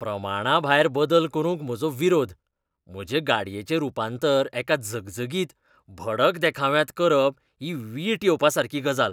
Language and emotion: Goan Konkani, disgusted